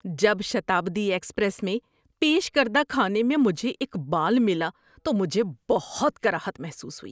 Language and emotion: Urdu, disgusted